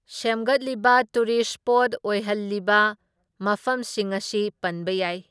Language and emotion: Manipuri, neutral